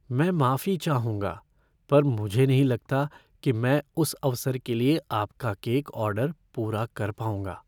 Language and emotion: Hindi, fearful